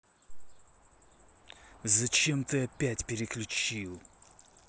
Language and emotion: Russian, angry